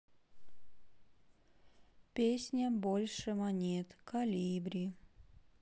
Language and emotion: Russian, sad